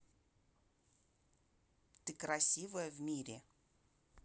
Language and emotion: Russian, neutral